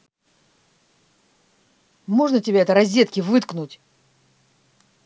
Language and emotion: Russian, angry